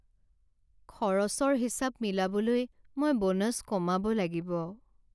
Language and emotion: Assamese, sad